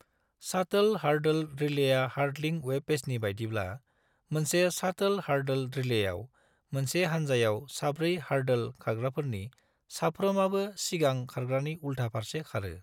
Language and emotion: Bodo, neutral